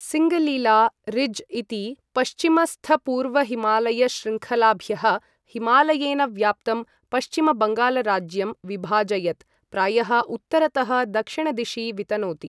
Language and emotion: Sanskrit, neutral